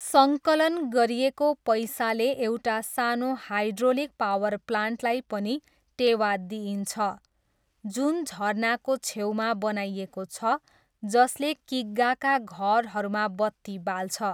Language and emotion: Nepali, neutral